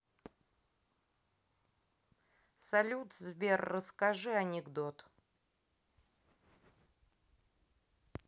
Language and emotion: Russian, neutral